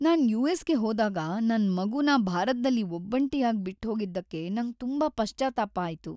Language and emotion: Kannada, sad